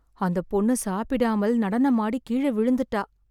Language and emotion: Tamil, sad